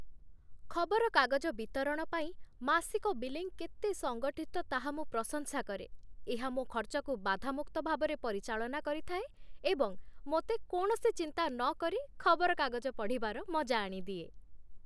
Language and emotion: Odia, happy